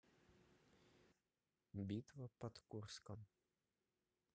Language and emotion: Russian, neutral